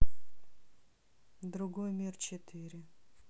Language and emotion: Russian, sad